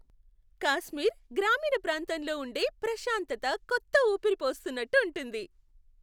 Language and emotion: Telugu, happy